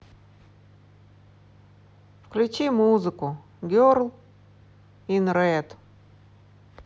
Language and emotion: Russian, neutral